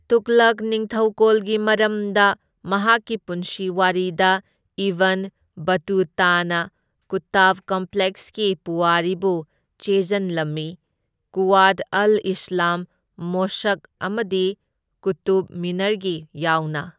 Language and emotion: Manipuri, neutral